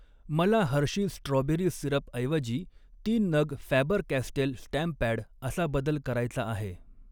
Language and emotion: Marathi, neutral